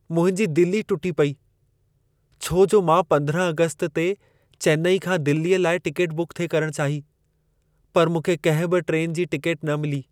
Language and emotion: Sindhi, sad